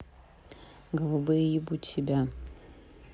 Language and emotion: Russian, neutral